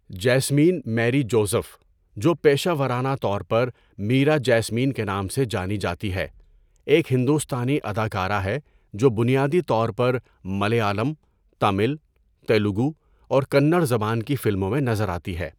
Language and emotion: Urdu, neutral